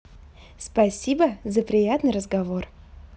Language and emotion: Russian, positive